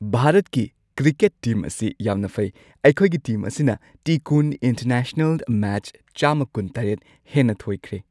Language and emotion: Manipuri, happy